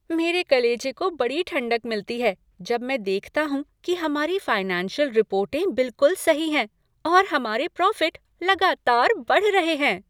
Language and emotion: Hindi, happy